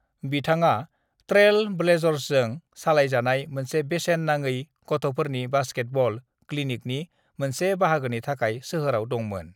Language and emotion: Bodo, neutral